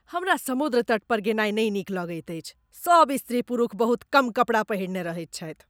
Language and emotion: Maithili, disgusted